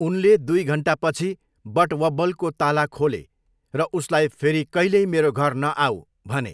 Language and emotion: Nepali, neutral